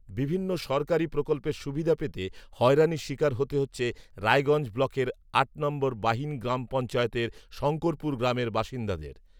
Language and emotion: Bengali, neutral